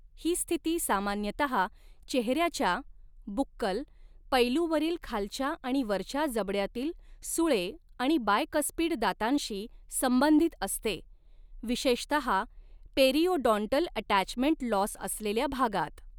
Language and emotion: Marathi, neutral